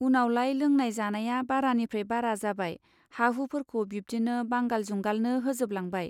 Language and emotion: Bodo, neutral